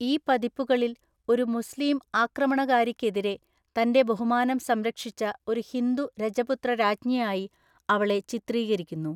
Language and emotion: Malayalam, neutral